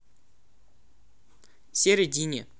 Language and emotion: Russian, positive